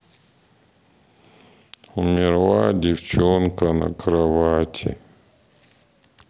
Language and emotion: Russian, sad